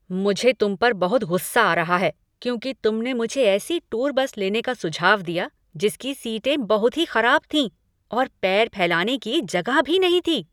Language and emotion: Hindi, angry